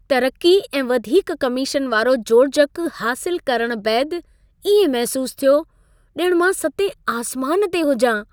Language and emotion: Sindhi, happy